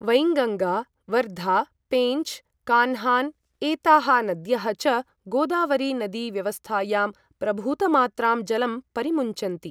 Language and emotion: Sanskrit, neutral